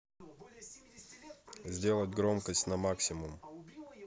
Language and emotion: Russian, neutral